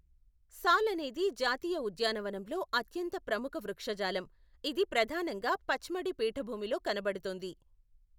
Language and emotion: Telugu, neutral